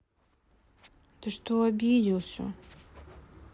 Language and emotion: Russian, sad